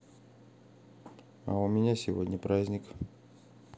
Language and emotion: Russian, neutral